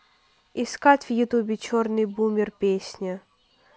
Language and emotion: Russian, neutral